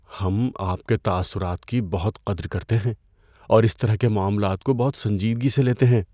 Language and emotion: Urdu, fearful